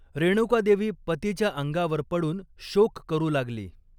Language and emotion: Marathi, neutral